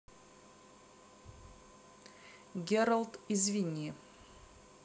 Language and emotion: Russian, neutral